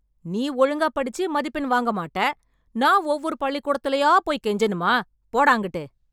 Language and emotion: Tamil, angry